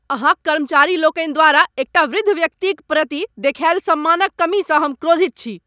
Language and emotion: Maithili, angry